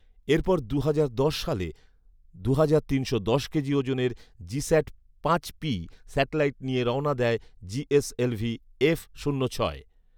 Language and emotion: Bengali, neutral